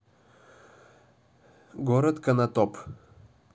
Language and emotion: Russian, neutral